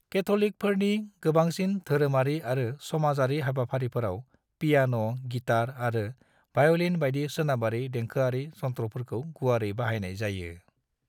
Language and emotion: Bodo, neutral